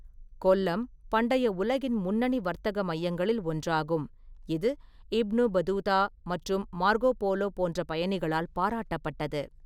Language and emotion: Tamil, neutral